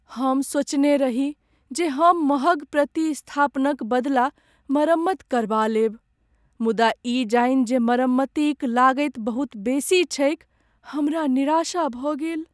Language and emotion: Maithili, sad